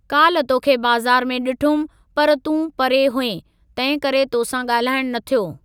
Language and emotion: Sindhi, neutral